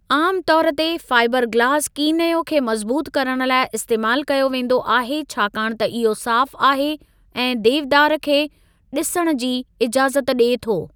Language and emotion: Sindhi, neutral